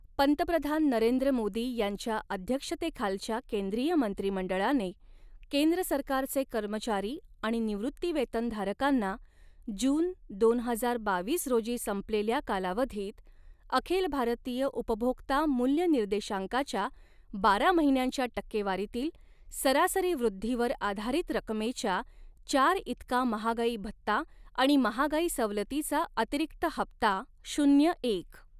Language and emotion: Marathi, neutral